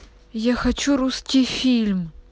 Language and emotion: Russian, angry